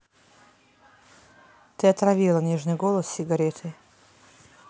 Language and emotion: Russian, neutral